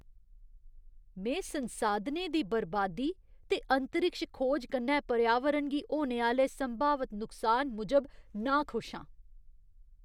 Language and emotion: Dogri, disgusted